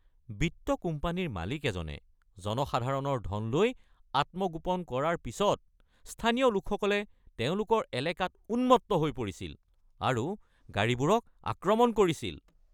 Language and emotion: Assamese, angry